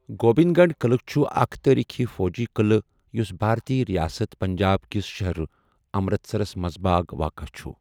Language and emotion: Kashmiri, neutral